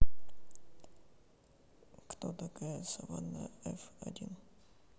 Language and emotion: Russian, neutral